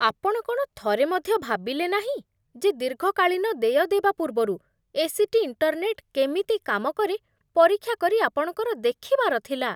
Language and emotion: Odia, disgusted